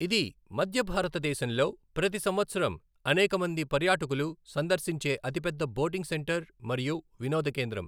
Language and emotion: Telugu, neutral